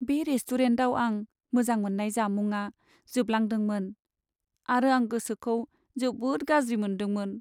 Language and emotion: Bodo, sad